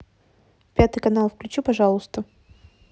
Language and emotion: Russian, neutral